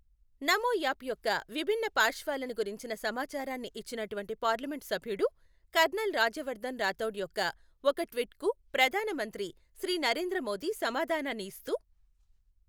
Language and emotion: Telugu, neutral